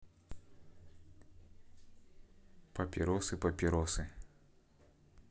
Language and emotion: Russian, neutral